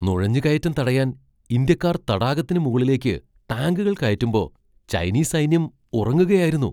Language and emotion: Malayalam, surprised